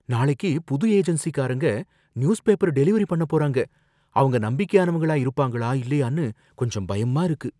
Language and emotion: Tamil, fearful